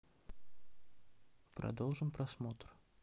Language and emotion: Russian, neutral